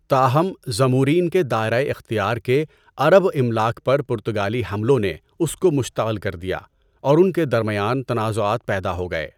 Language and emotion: Urdu, neutral